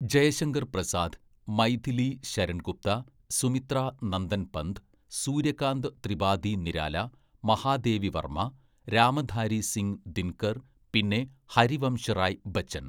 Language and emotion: Malayalam, neutral